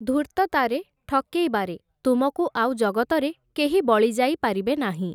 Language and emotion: Odia, neutral